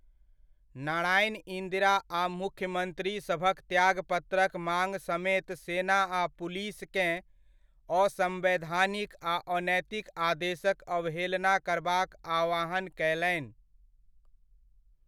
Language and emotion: Maithili, neutral